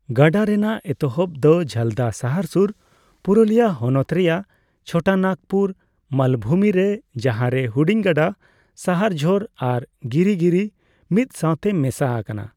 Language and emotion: Santali, neutral